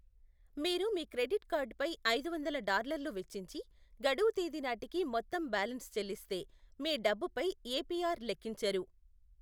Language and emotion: Telugu, neutral